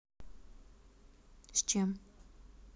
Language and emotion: Russian, neutral